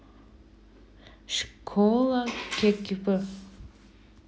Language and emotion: Russian, neutral